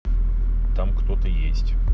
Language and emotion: Russian, neutral